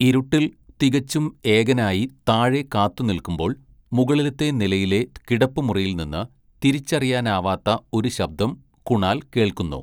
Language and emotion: Malayalam, neutral